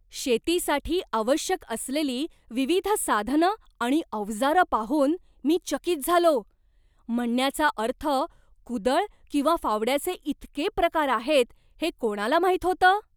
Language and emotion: Marathi, surprised